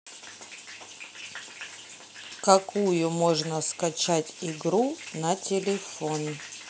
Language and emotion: Russian, neutral